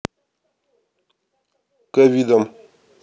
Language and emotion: Russian, neutral